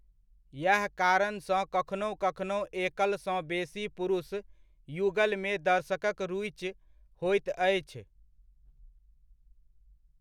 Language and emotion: Maithili, neutral